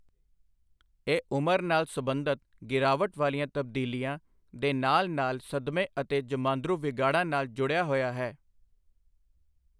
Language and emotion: Punjabi, neutral